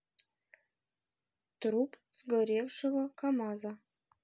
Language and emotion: Russian, neutral